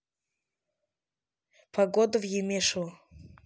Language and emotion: Russian, neutral